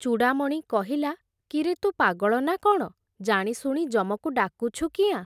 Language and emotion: Odia, neutral